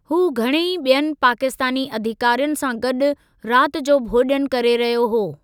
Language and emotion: Sindhi, neutral